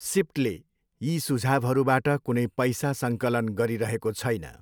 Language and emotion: Nepali, neutral